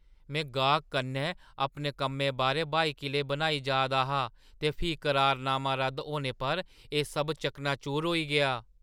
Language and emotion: Dogri, surprised